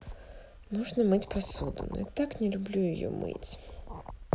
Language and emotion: Russian, sad